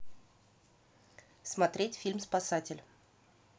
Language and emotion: Russian, neutral